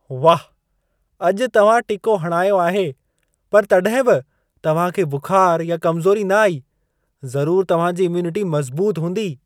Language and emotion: Sindhi, surprised